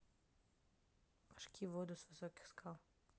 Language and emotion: Russian, neutral